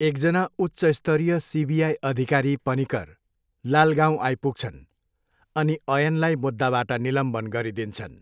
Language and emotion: Nepali, neutral